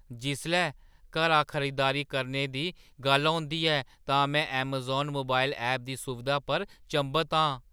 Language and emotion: Dogri, surprised